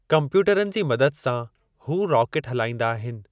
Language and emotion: Sindhi, neutral